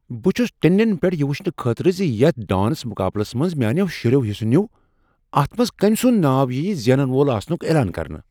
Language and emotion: Kashmiri, surprised